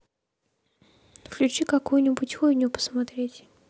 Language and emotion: Russian, neutral